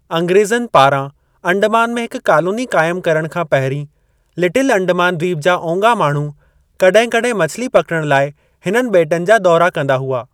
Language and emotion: Sindhi, neutral